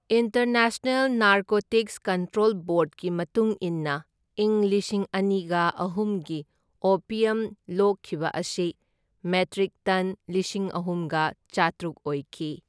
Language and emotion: Manipuri, neutral